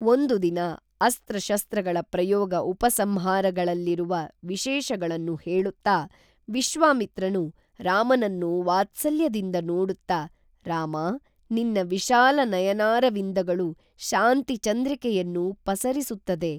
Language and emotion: Kannada, neutral